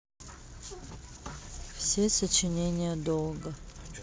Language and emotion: Russian, sad